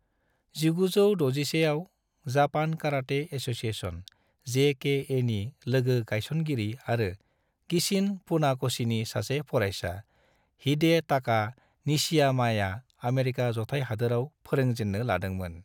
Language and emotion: Bodo, neutral